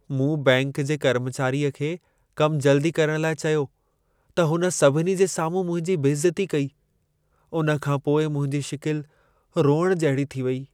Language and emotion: Sindhi, sad